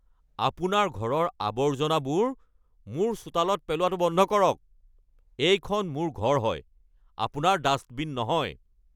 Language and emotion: Assamese, angry